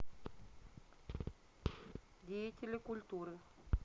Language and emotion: Russian, neutral